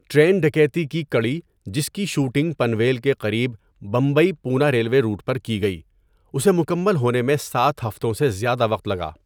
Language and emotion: Urdu, neutral